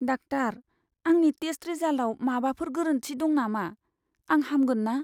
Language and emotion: Bodo, fearful